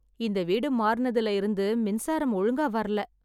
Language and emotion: Tamil, sad